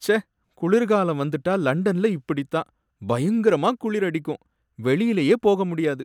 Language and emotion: Tamil, sad